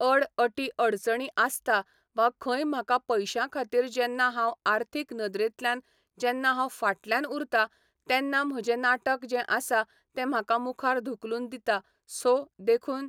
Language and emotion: Goan Konkani, neutral